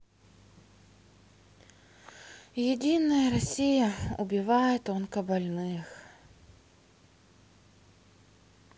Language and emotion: Russian, sad